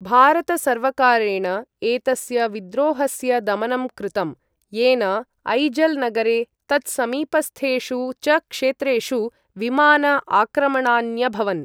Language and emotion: Sanskrit, neutral